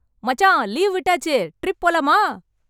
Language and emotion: Tamil, happy